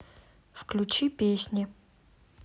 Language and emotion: Russian, neutral